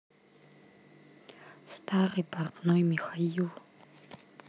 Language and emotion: Russian, neutral